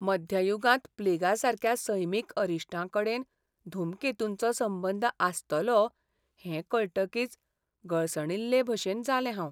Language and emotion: Goan Konkani, sad